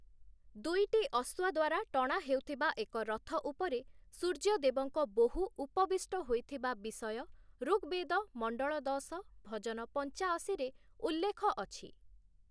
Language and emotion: Odia, neutral